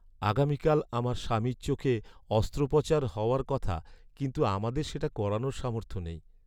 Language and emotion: Bengali, sad